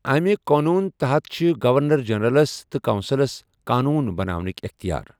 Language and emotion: Kashmiri, neutral